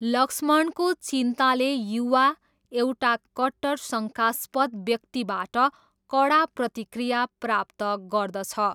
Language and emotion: Nepali, neutral